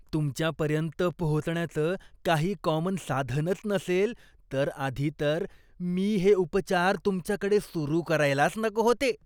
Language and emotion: Marathi, disgusted